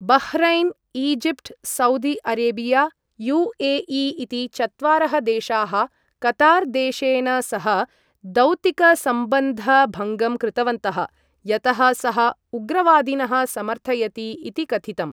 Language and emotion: Sanskrit, neutral